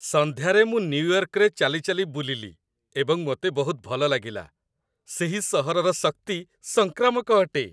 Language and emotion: Odia, happy